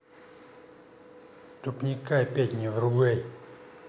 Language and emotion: Russian, angry